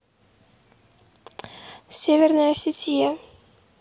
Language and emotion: Russian, neutral